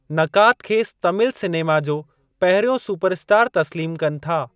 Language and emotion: Sindhi, neutral